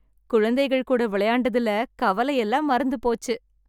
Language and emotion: Tamil, happy